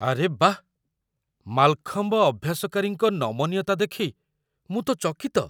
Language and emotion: Odia, surprised